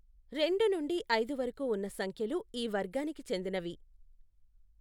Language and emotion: Telugu, neutral